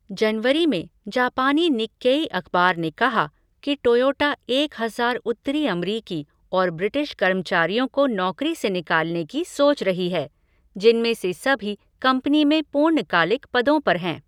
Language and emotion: Hindi, neutral